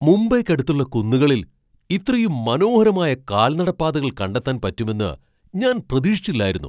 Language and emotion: Malayalam, surprised